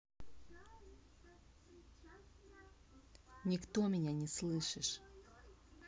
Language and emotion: Russian, neutral